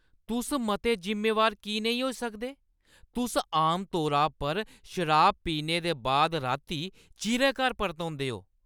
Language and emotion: Dogri, angry